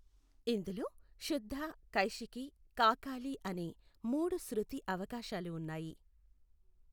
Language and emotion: Telugu, neutral